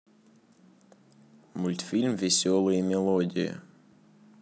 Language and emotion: Russian, neutral